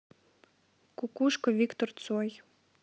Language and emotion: Russian, neutral